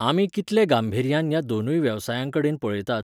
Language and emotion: Goan Konkani, neutral